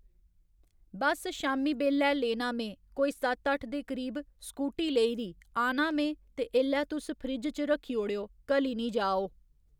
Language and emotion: Dogri, neutral